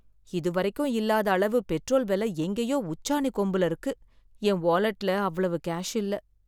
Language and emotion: Tamil, sad